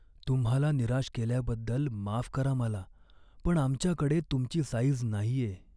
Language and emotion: Marathi, sad